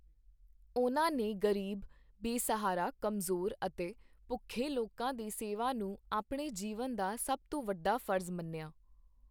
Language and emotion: Punjabi, neutral